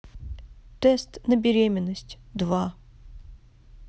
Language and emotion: Russian, neutral